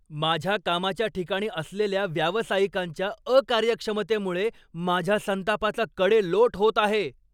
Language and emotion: Marathi, angry